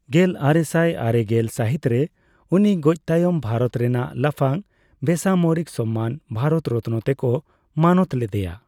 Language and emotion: Santali, neutral